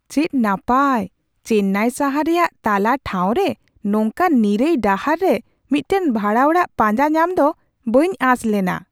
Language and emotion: Santali, surprised